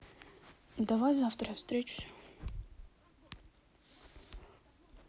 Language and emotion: Russian, neutral